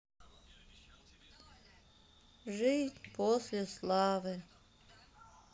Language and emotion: Russian, sad